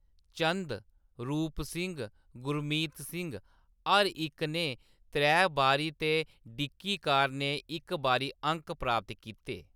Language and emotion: Dogri, neutral